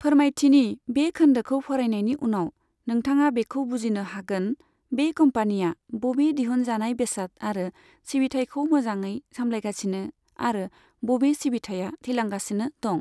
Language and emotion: Bodo, neutral